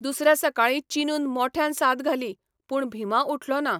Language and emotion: Goan Konkani, neutral